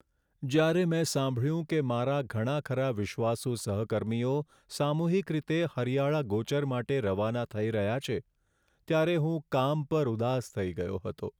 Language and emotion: Gujarati, sad